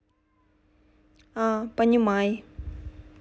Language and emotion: Russian, neutral